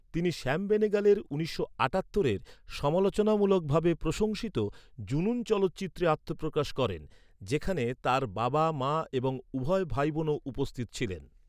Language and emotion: Bengali, neutral